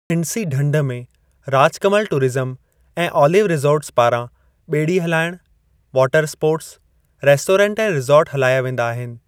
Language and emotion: Sindhi, neutral